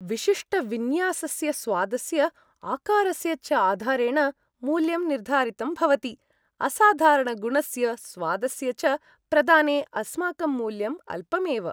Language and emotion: Sanskrit, happy